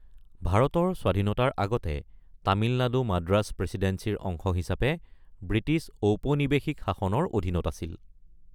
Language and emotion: Assamese, neutral